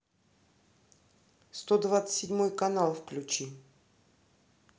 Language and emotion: Russian, neutral